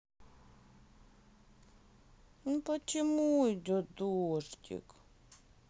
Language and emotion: Russian, sad